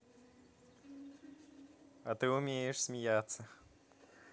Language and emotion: Russian, positive